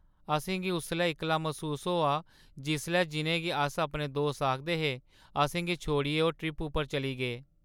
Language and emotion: Dogri, sad